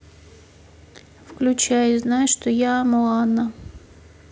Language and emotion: Russian, neutral